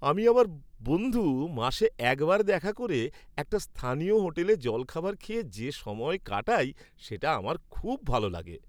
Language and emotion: Bengali, happy